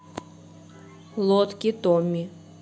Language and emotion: Russian, neutral